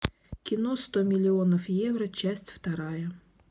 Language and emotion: Russian, neutral